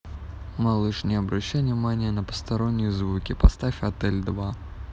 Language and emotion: Russian, neutral